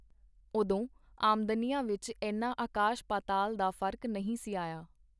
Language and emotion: Punjabi, neutral